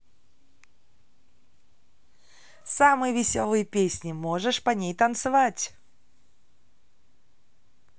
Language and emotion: Russian, positive